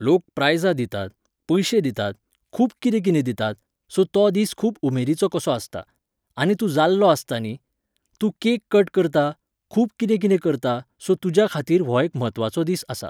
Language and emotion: Goan Konkani, neutral